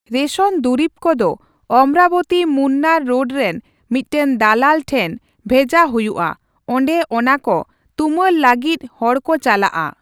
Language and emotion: Santali, neutral